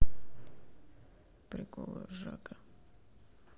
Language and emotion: Russian, sad